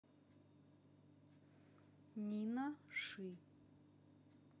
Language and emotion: Russian, neutral